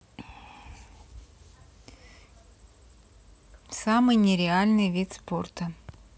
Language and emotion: Russian, neutral